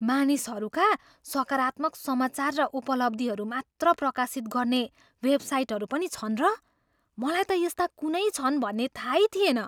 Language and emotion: Nepali, surprised